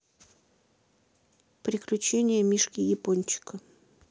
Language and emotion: Russian, neutral